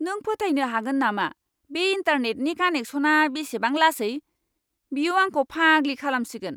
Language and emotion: Bodo, angry